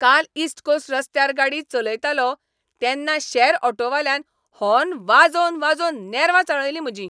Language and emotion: Goan Konkani, angry